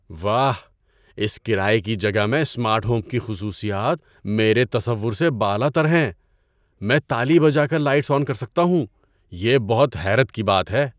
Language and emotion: Urdu, surprised